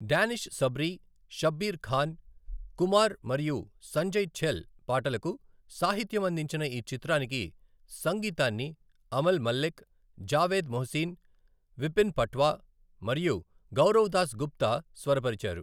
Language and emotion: Telugu, neutral